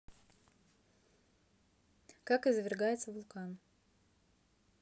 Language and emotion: Russian, neutral